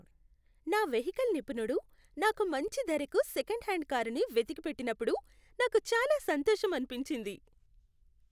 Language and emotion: Telugu, happy